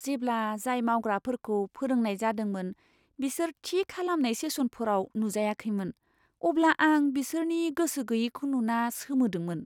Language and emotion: Bodo, surprised